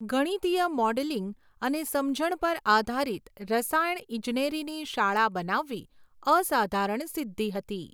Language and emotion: Gujarati, neutral